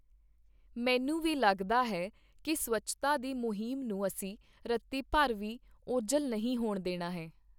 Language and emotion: Punjabi, neutral